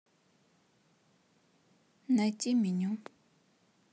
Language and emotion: Russian, neutral